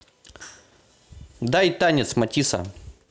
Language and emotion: Russian, neutral